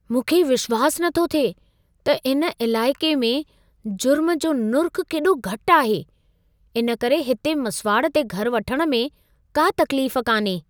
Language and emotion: Sindhi, surprised